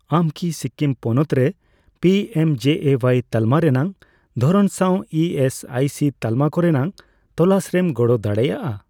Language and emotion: Santali, neutral